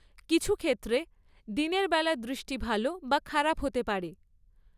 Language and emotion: Bengali, neutral